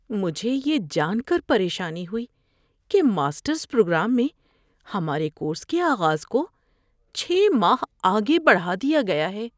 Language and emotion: Urdu, fearful